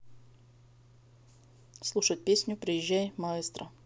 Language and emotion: Russian, neutral